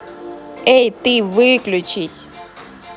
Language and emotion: Russian, angry